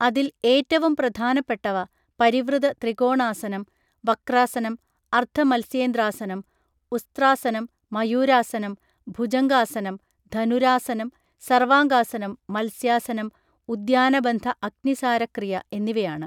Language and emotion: Malayalam, neutral